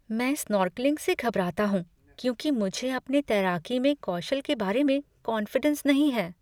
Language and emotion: Hindi, fearful